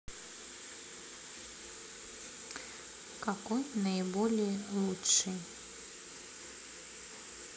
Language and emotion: Russian, neutral